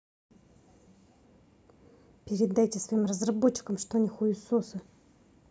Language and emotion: Russian, angry